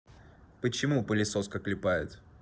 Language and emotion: Russian, neutral